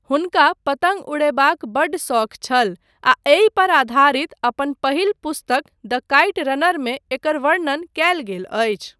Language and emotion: Maithili, neutral